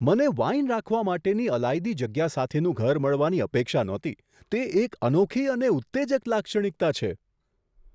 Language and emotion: Gujarati, surprised